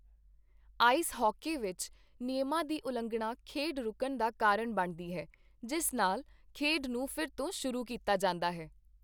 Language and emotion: Punjabi, neutral